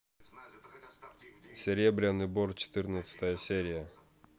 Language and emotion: Russian, neutral